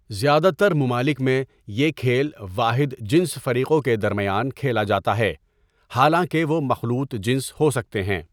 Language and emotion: Urdu, neutral